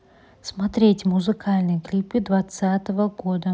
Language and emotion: Russian, neutral